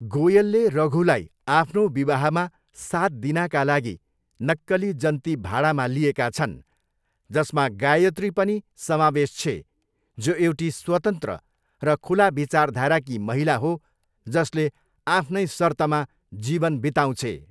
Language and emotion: Nepali, neutral